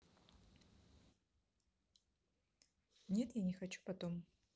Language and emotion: Russian, neutral